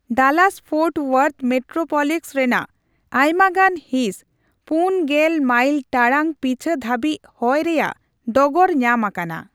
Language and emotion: Santali, neutral